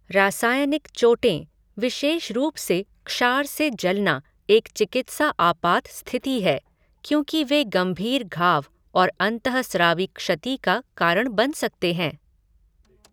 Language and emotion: Hindi, neutral